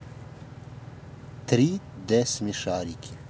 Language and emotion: Russian, neutral